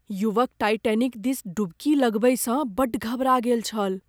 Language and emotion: Maithili, fearful